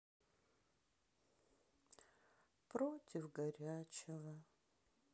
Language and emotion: Russian, sad